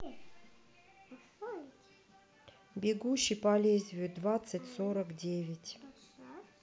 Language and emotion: Russian, neutral